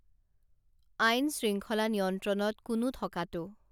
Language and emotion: Assamese, neutral